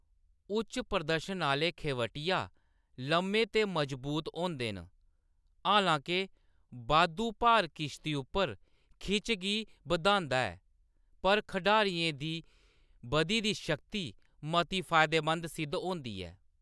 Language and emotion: Dogri, neutral